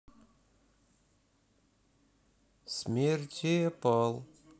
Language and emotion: Russian, neutral